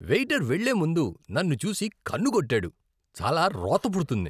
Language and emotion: Telugu, disgusted